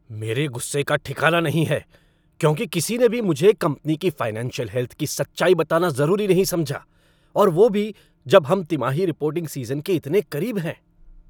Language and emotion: Hindi, angry